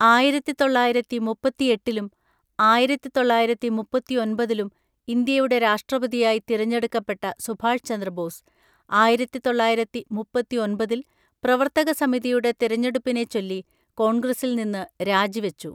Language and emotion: Malayalam, neutral